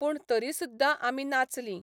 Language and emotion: Goan Konkani, neutral